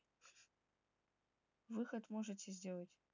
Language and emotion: Russian, neutral